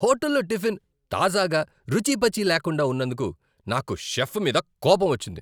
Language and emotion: Telugu, angry